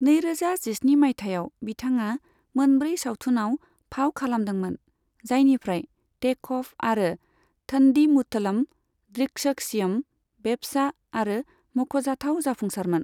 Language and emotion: Bodo, neutral